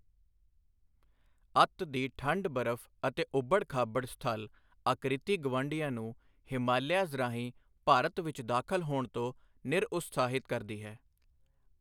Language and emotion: Punjabi, neutral